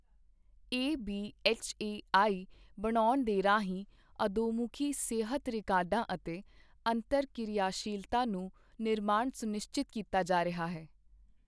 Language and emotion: Punjabi, neutral